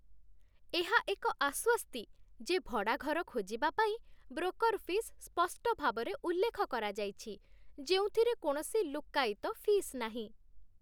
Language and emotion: Odia, happy